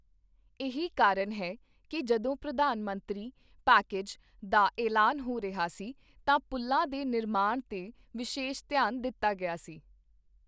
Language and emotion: Punjabi, neutral